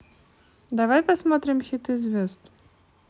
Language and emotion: Russian, neutral